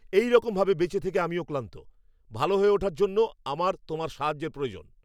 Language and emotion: Bengali, angry